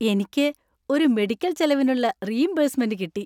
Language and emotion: Malayalam, happy